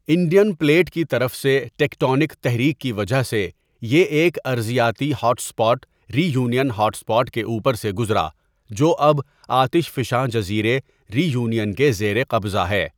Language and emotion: Urdu, neutral